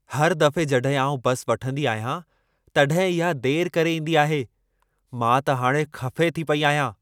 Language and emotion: Sindhi, angry